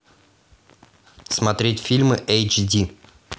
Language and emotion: Russian, neutral